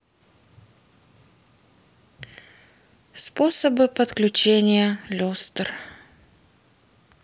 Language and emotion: Russian, sad